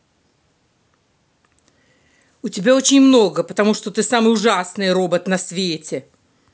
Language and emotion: Russian, angry